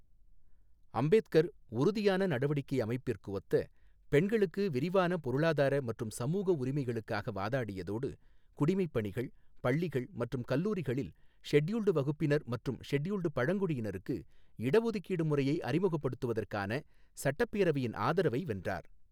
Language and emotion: Tamil, neutral